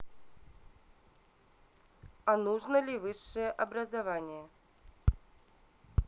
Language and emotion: Russian, neutral